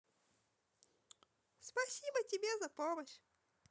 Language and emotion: Russian, positive